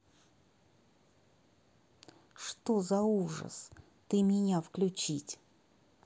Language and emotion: Russian, angry